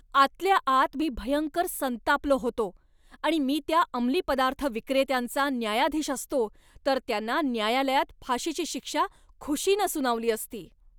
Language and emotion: Marathi, angry